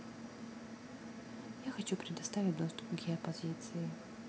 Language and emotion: Russian, neutral